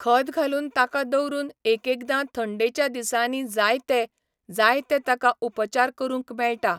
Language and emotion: Goan Konkani, neutral